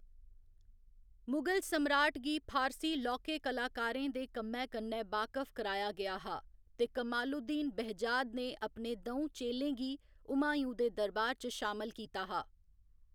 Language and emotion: Dogri, neutral